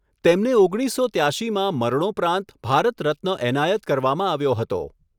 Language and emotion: Gujarati, neutral